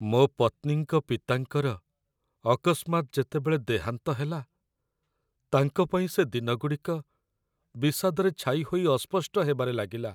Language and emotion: Odia, sad